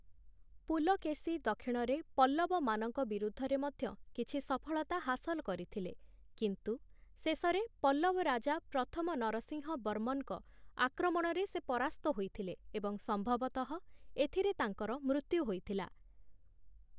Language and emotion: Odia, neutral